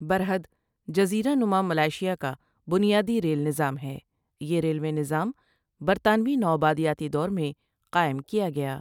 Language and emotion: Urdu, neutral